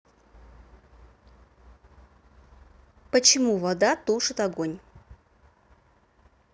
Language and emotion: Russian, neutral